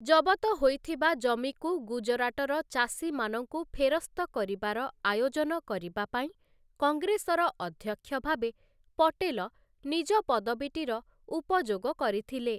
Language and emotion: Odia, neutral